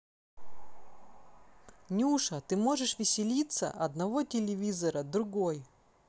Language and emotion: Russian, neutral